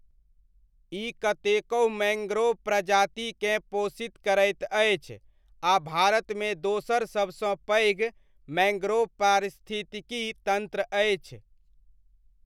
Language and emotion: Maithili, neutral